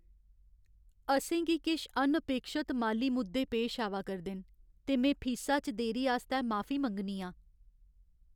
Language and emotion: Dogri, sad